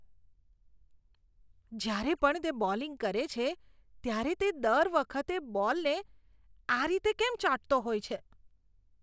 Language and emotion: Gujarati, disgusted